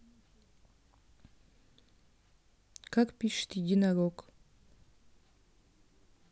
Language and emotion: Russian, neutral